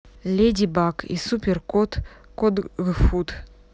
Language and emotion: Russian, neutral